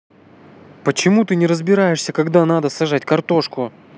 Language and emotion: Russian, angry